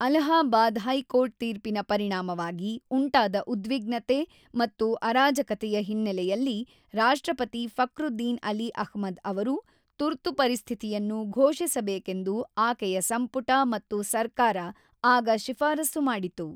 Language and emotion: Kannada, neutral